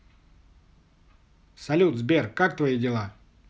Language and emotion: Russian, positive